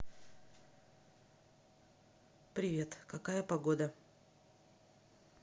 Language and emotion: Russian, neutral